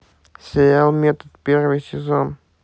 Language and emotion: Russian, neutral